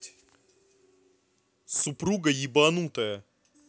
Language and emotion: Russian, angry